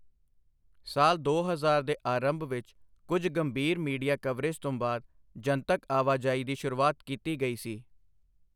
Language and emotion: Punjabi, neutral